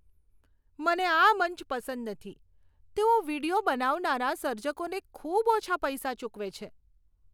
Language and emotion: Gujarati, disgusted